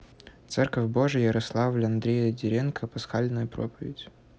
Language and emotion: Russian, neutral